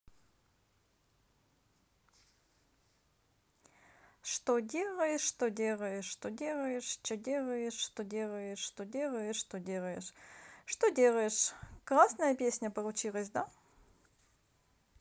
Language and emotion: Russian, positive